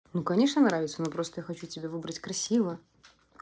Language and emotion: Russian, neutral